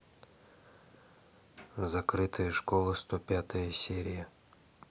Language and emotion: Russian, neutral